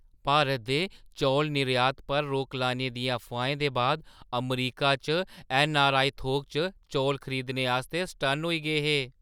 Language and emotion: Dogri, surprised